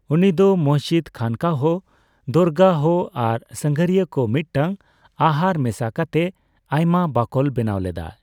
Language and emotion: Santali, neutral